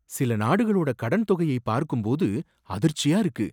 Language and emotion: Tamil, surprised